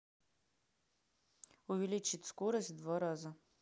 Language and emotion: Russian, neutral